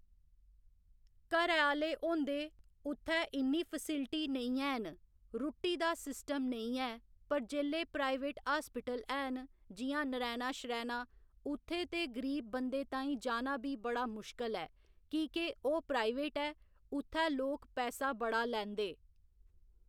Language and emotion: Dogri, neutral